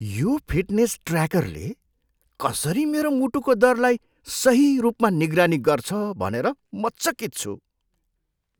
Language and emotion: Nepali, surprised